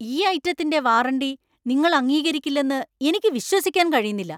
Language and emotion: Malayalam, angry